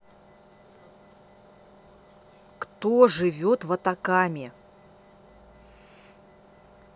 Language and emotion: Russian, angry